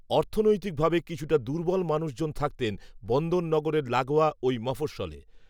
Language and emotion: Bengali, neutral